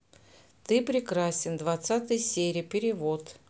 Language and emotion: Russian, neutral